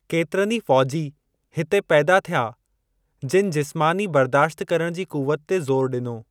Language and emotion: Sindhi, neutral